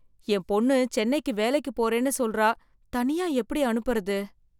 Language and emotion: Tamil, fearful